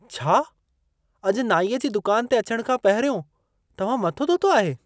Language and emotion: Sindhi, surprised